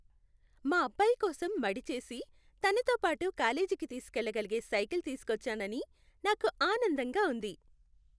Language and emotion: Telugu, happy